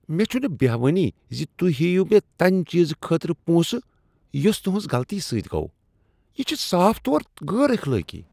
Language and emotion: Kashmiri, disgusted